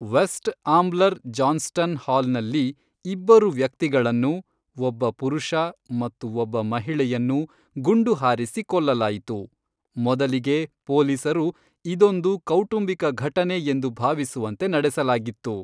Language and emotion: Kannada, neutral